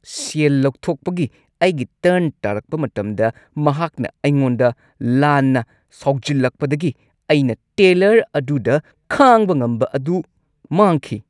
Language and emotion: Manipuri, angry